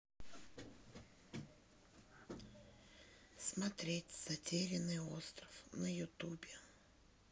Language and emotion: Russian, sad